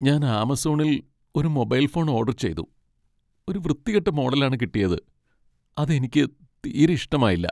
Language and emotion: Malayalam, sad